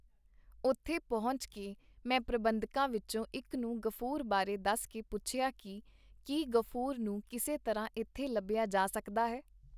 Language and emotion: Punjabi, neutral